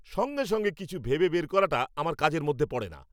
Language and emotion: Bengali, angry